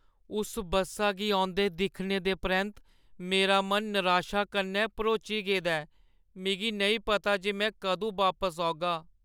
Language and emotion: Dogri, sad